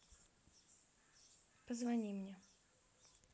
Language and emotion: Russian, neutral